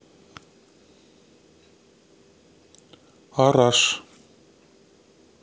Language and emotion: Russian, neutral